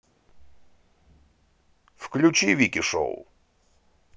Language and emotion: Russian, neutral